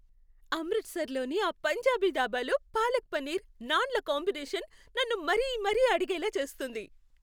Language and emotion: Telugu, happy